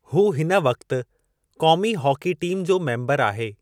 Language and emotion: Sindhi, neutral